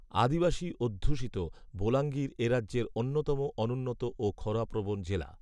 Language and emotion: Bengali, neutral